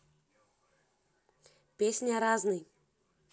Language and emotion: Russian, neutral